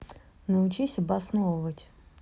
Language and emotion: Russian, neutral